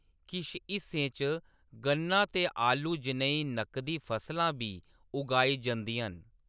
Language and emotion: Dogri, neutral